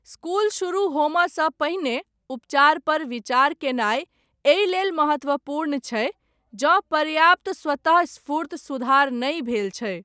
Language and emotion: Maithili, neutral